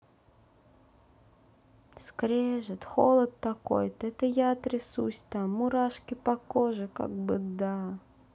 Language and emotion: Russian, sad